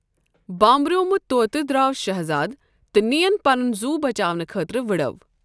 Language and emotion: Kashmiri, neutral